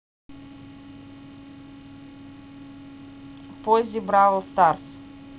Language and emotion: Russian, neutral